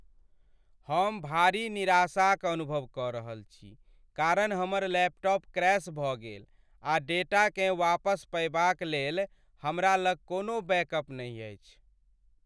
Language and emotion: Maithili, sad